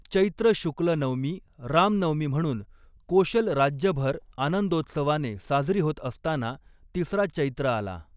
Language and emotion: Marathi, neutral